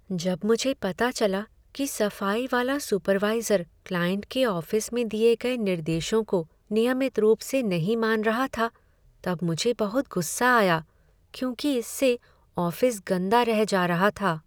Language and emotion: Hindi, sad